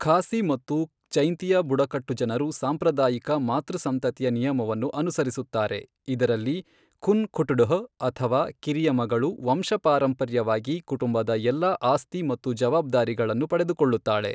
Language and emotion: Kannada, neutral